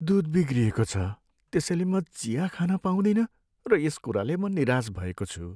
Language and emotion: Nepali, sad